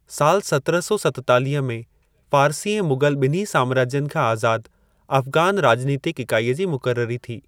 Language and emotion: Sindhi, neutral